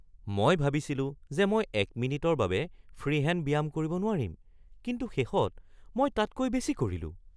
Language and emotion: Assamese, surprised